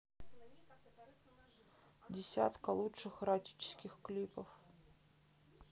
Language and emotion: Russian, sad